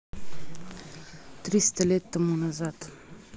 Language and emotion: Russian, neutral